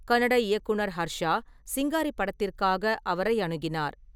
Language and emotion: Tamil, neutral